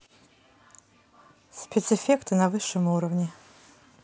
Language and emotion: Russian, neutral